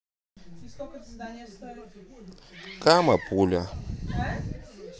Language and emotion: Russian, neutral